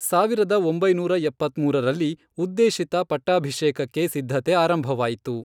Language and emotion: Kannada, neutral